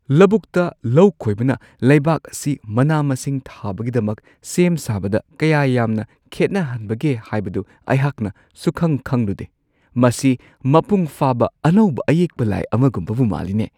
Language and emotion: Manipuri, surprised